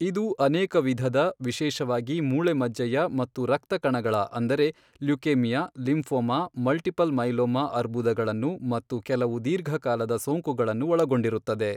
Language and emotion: Kannada, neutral